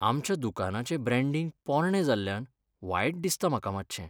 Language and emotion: Goan Konkani, sad